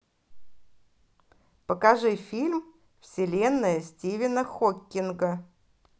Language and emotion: Russian, positive